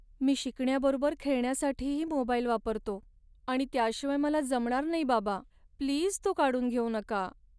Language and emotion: Marathi, sad